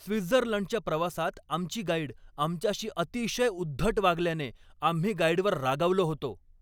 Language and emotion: Marathi, angry